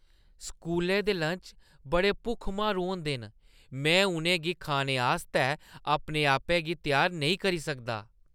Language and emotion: Dogri, disgusted